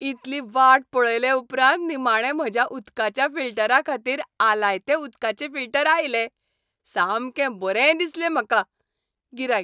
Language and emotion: Goan Konkani, happy